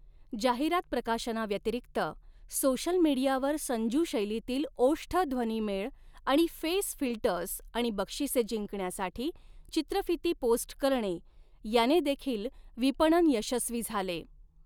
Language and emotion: Marathi, neutral